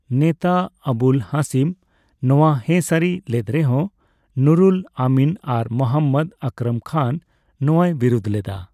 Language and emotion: Santali, neutral